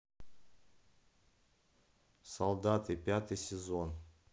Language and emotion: Russian, neutral